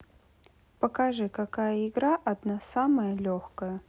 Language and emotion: Russian, neutral